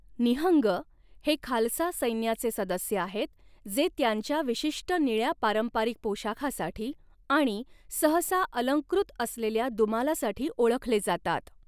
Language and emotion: Marathi, neutral